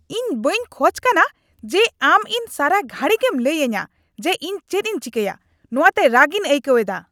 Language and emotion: Santali, angry